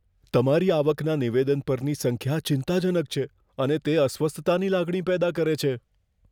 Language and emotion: Gujarati, fearful